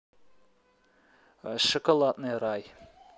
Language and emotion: Russian, neutral